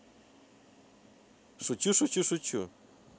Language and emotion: Russian, positive